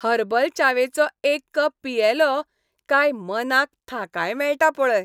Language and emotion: Goan Konkani, happy